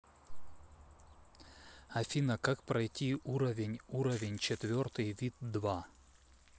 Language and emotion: Russian, neutral